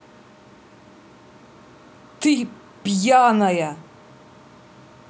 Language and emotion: Russian, angry